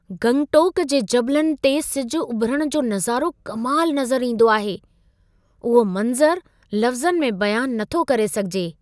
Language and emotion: Sindhi, surprised